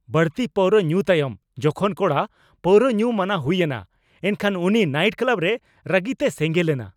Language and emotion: Santali, angry